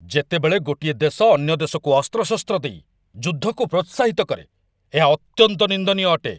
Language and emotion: Odia, angry